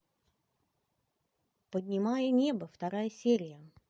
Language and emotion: Russian, positive